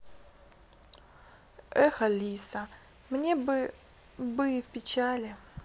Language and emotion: Russian, sad